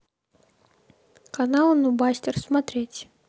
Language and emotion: Russian, neutral